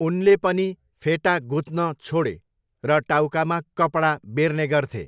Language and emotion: Nepali, neutral